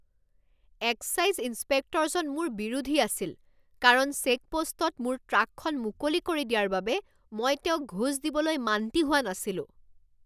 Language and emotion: Assamese, angry